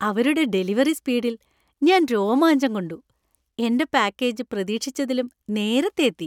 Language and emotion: Malayalam, happy